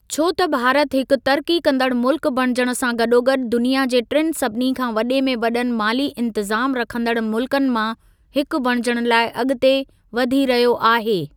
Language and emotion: Sindhi, neutral